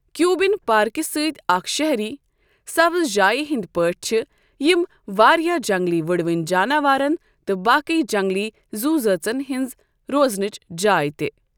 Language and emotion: Kashmiri, neutral